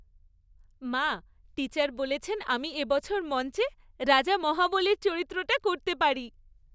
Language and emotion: Bengali, happy